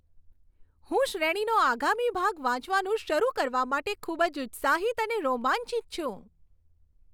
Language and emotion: Gujarati, happy